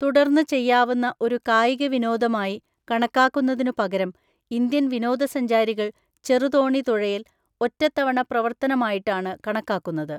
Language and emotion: Malayalam, neutral